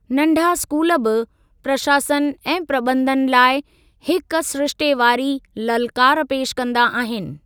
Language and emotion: Sindhi, neutral